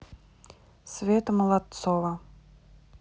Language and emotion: Russian, neutral